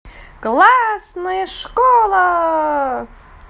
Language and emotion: Russian, positive